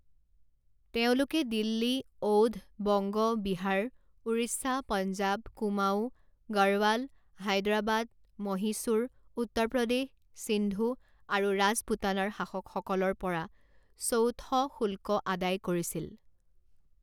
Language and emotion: Assamese, neutral